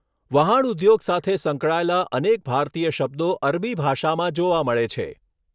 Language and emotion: Gujarati, neutral